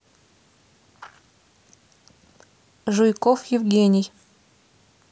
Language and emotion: Russian, neutral